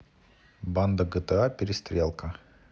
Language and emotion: Russian, neutral